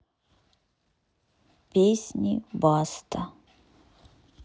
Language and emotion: Russian, neutral